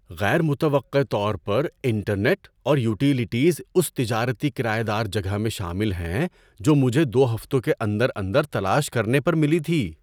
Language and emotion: Urdu, surprised